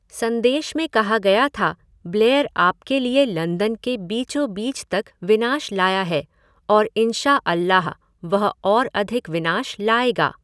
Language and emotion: Hindi, neutral